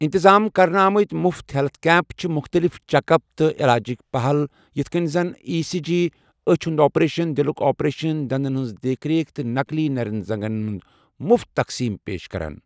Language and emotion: Kashmiri, neutral